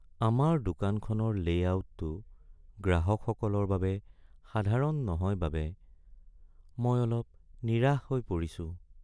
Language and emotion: Assamese, sad